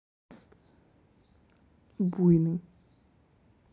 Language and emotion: Russian, neutral